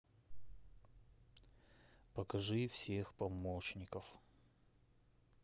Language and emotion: Russian, neutral